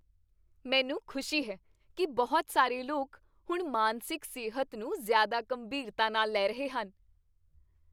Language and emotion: Punjabi, happy